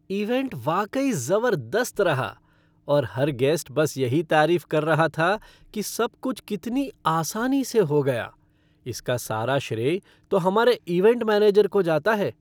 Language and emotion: Hindi, happy